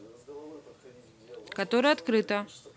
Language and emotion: Russian, neutral